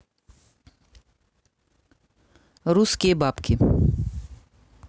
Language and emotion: Russian, neutral